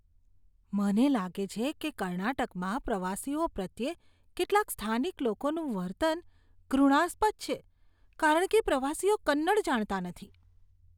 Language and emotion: Gujarati, disgusted